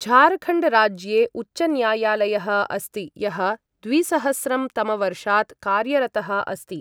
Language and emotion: Sanskrit, neutral